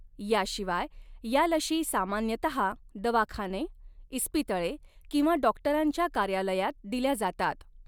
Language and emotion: Marathi, neutral